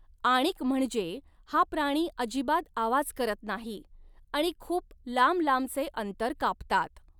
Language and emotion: Marathi, neutral